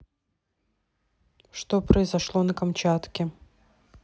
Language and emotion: Russian, neutral